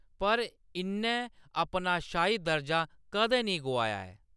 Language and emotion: Dogri, neutral